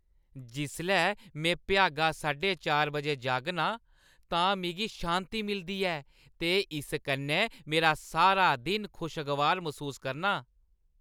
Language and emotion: Dogri, happy